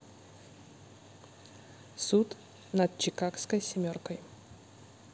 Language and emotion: Russian, neutral